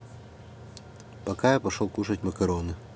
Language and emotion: Russian, neutral